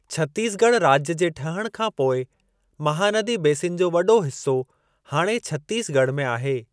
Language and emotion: Sindhi, neutral